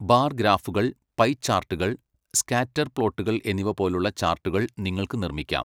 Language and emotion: Malayalam, neutral